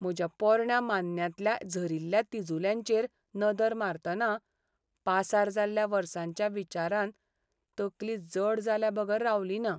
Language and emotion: Goan Konkani, sad